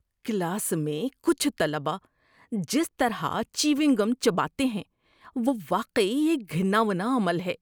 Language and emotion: Urdu, disgusted